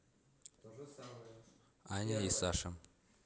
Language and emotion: Russian, neutral